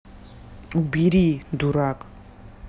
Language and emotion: Russian, angry